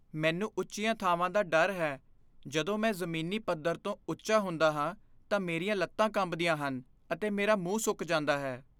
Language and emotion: Punjabi, fearful